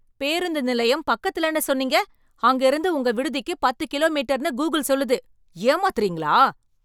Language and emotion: Tamil, angry